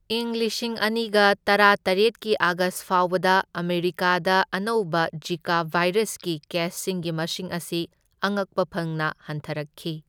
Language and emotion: Manipuri, neutral